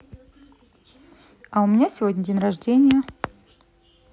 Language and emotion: Russian, neutral